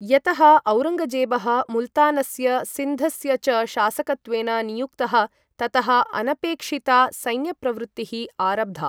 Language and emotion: Sanskrit, neutral